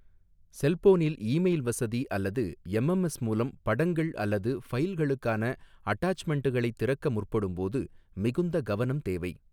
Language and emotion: Tamil, neutral